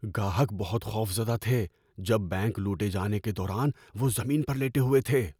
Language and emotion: Urdu, fearful